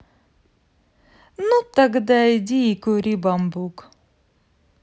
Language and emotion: Russian, positive